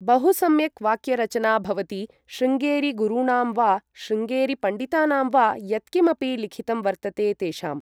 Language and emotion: Sanskrit, neutral